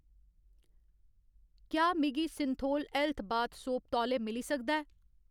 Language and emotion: Dogri, neutral